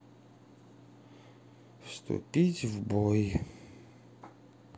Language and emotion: Russian, sad